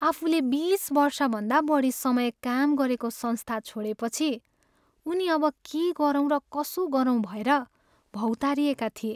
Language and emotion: Nepali, sad